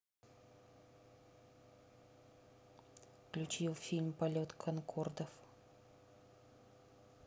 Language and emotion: Russian, neutral